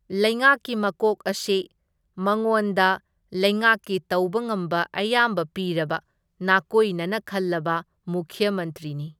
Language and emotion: Manipuri, neutral